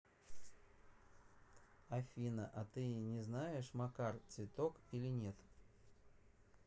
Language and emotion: Russian, neutral